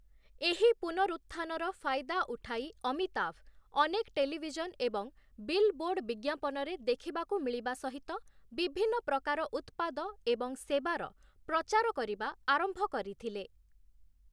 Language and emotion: Odia, neutral